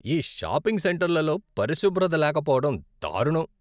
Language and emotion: Telugu, disgusted